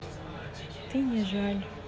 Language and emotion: Russian, sad